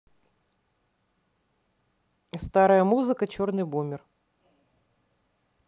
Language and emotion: Russian, neutral